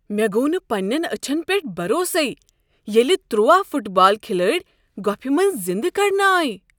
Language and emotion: Kashmiri, surprised